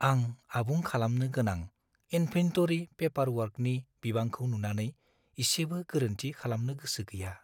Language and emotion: Bodo, fearful